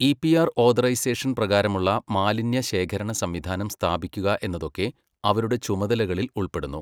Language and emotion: Malayalam, neutral